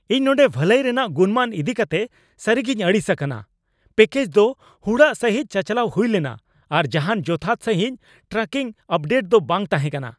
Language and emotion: Santali, angry